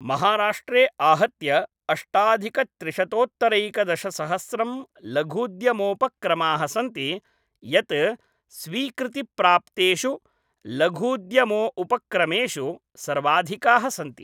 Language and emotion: Sanskrit, neutral